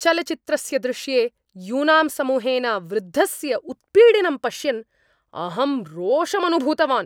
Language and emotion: Sanskrit, angry